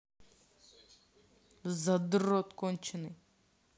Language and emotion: Russian, angry